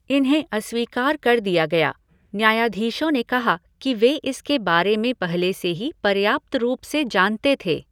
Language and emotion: Hindi, neutral